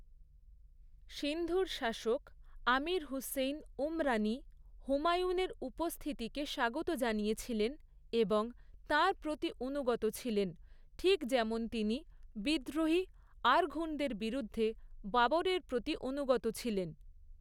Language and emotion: Bengali, neutral